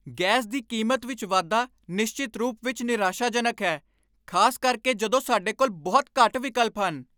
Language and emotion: Punjabi, angry